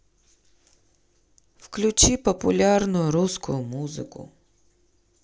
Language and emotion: Russian, sad